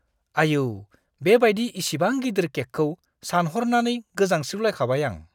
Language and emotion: Bodo, disgusted